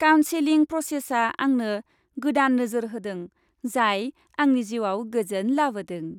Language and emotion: Bodo, happy